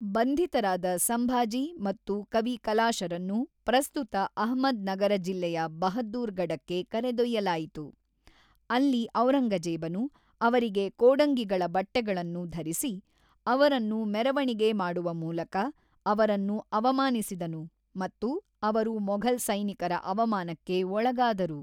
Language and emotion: Kannada, neutral